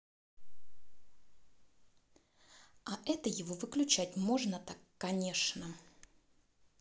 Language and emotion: Russian, angry